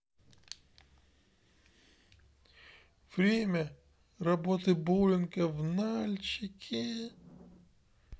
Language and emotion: Russian, sad